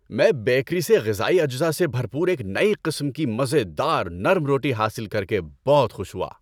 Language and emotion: Urdu, happy